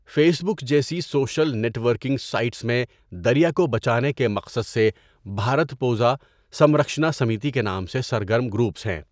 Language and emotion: Urdu, neutral